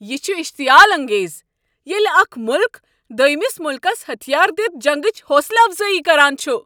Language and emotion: Kashmiri, angry